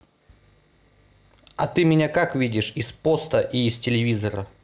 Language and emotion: Russian, neutral